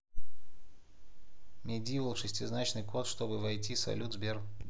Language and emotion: Russian, neutral